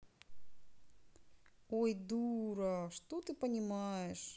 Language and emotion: Russian, sad